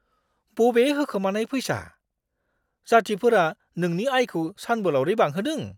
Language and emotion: Bodo, surprised